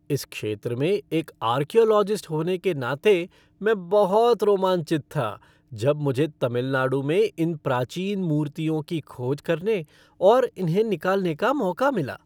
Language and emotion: Hindi, happy